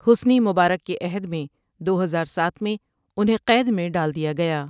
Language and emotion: Urdu, neutral